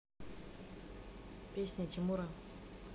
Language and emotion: Russian, neutral